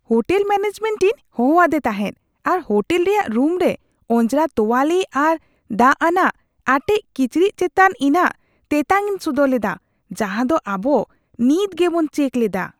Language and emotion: Santali, disgusted